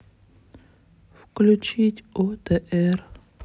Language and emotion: Russian, sad